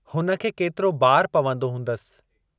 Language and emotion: Sindhi, neutral